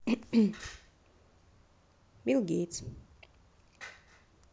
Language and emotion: Russian, neutral